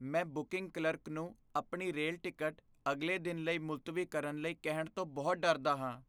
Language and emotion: Punjabi, fearful